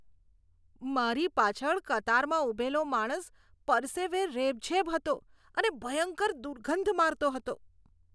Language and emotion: Gujarati, disgusted